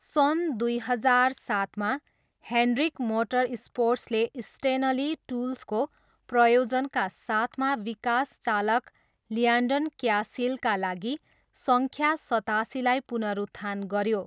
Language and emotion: Nepali, neutral